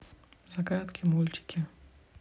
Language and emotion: Russian, neutral